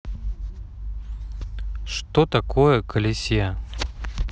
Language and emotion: Russian, neutral